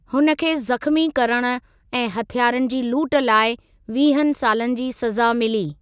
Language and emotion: Sindhi, neutral